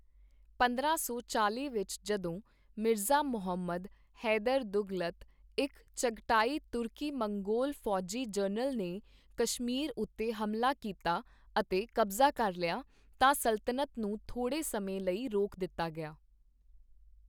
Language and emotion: Punjabi, neutral